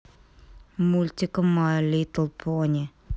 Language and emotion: Russian, angry